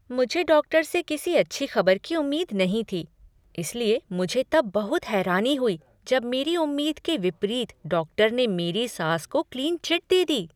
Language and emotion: Hindi, surprised